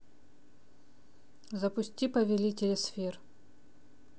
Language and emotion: Russian, neutral